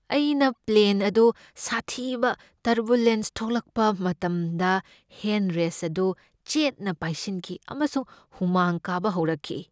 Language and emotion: Manipuri, fearful